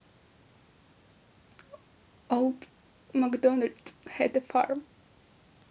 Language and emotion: Russian, neutral